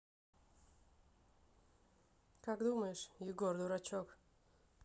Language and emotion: Russian, neutral